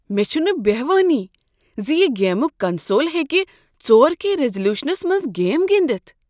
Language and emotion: Kashmiri, surprised